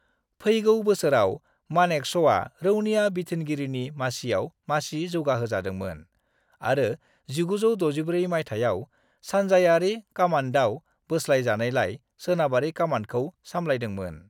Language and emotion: Bodo, neutral